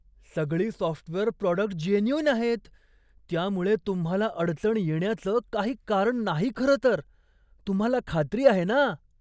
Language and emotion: Marathi, surprised